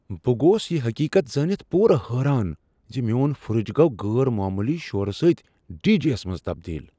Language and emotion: Kashmiri, surprised